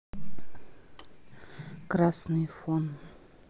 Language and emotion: Russian, neutral